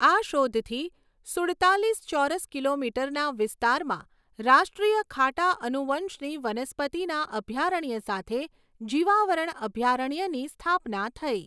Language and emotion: Gujarati, neutral